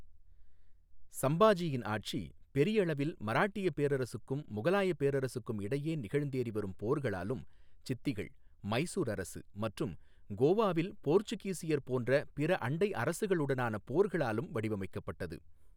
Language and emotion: Tamil, neutral